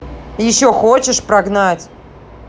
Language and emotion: Russian, angry